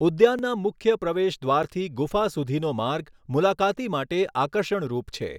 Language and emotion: Gujarati, neutral